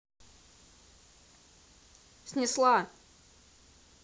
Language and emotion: Russian, angry